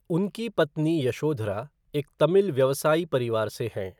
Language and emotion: Hindi, neutral